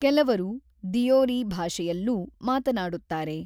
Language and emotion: Kannada, neutral